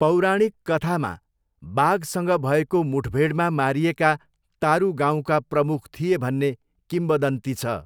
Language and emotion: Nepali, neutral